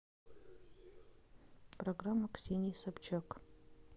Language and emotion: Russian, neutral